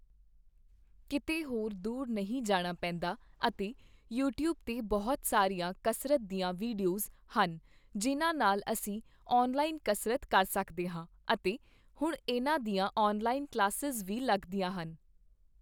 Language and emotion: Punjabi, neutral